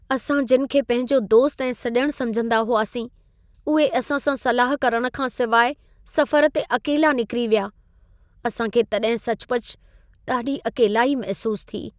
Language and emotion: Sindhi, sad